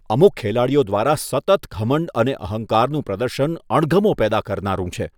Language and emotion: Gujarati, disgusted